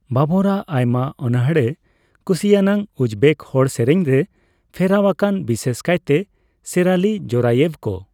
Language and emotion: Santali, neutral